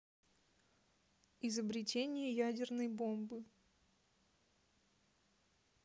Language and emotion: Russian, neutral